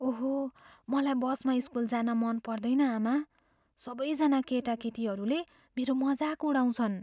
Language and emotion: Nepali, fearful